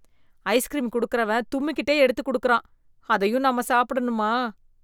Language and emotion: Tamil, disgusted